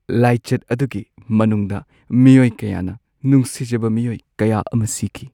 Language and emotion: Manipuri, sad